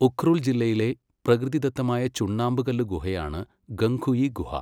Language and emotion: Malayalam, neutral